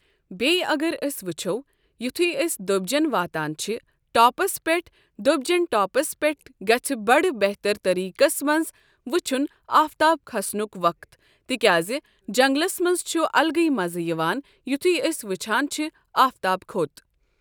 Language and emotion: Kashmiri, neutral